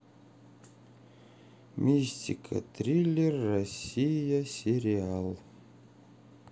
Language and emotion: Russian, sad